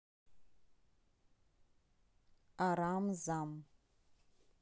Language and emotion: Russian, neutral